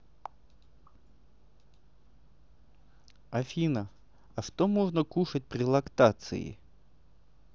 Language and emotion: Russian, neutral